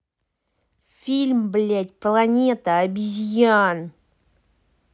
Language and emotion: Russian, angry